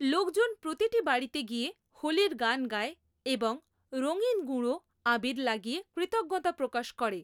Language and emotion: Bengali, neutral